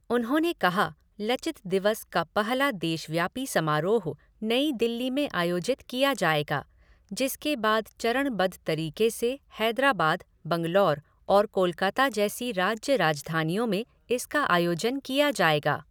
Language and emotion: Hindi, neutral